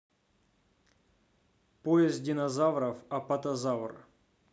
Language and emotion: Russian, neutral